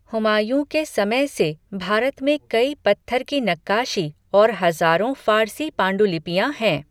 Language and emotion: Hindi, neutral